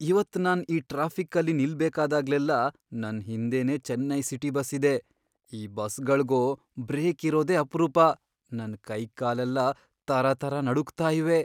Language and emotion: Kannada, fearful